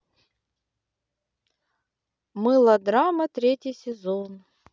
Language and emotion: Russian, neutral